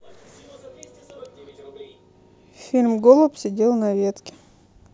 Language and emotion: Russian, neutral